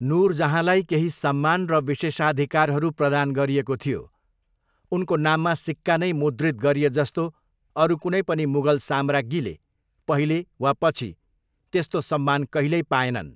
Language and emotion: Nepali, neutral